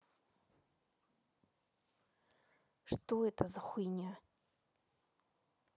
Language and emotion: Russian, angry